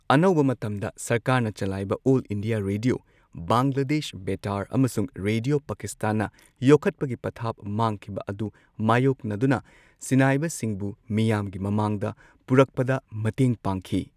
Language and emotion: Manipuri, neutral